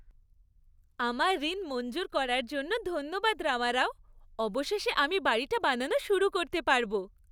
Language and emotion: Bengali, happy